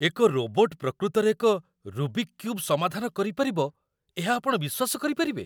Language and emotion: Odia, surprised